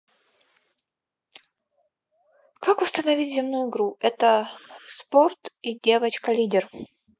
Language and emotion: Russian, neutral